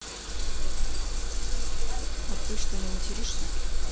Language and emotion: Russian, neutral